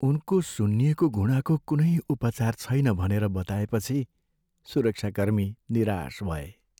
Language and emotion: Nepali, sad